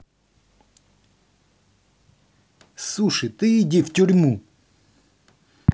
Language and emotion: Russian, angry